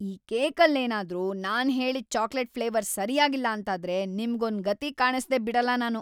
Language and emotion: Kannada, angry